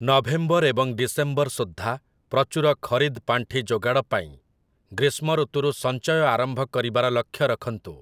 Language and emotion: Odia, neutral